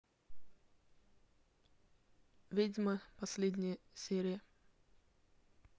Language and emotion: Russian, neutral